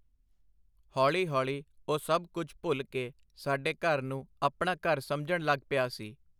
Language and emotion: Punjabi, neutral